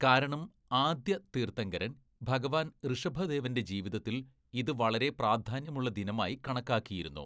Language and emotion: Malayalam, neutral